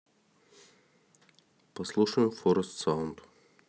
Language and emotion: Russian, neutral